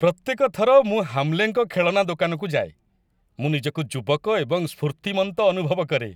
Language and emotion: Odia, happy